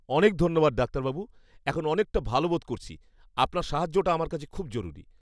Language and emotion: Bengali, happy